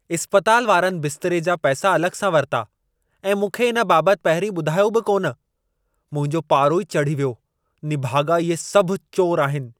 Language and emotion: Sindhi, angry